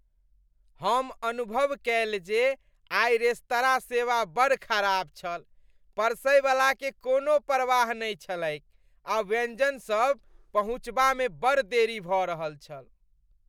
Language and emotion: Maithili, disgusted